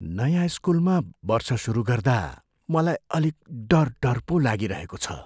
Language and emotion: Nepali, fearful